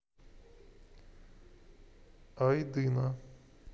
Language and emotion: Russian, neutral